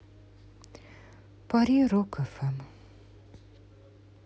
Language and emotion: Russian, sad